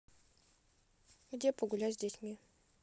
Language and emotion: Russian, neutral